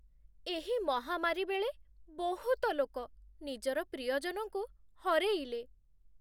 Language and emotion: Odia, sad